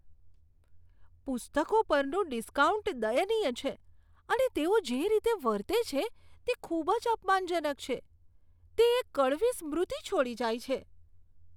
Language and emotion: Gujarati, disgusted